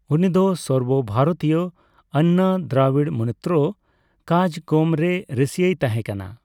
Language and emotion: Santali, neutral